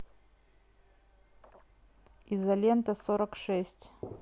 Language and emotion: Russian, neutral